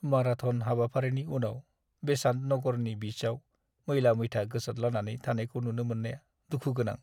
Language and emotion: Bodo, sad